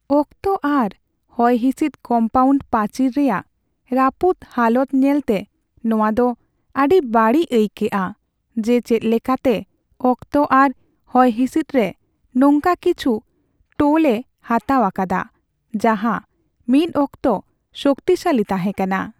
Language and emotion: Santali, sad